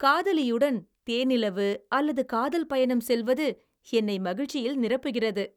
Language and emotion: Tamil, happy